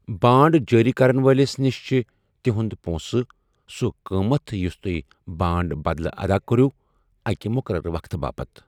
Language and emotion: Kashmiri, neutral